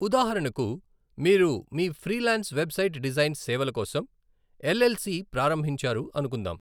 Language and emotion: Telugu, neutral